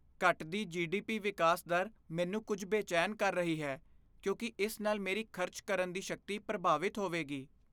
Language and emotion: Punjabi, fearful